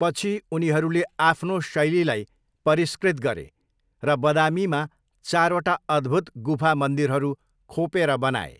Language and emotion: Nepali, neutral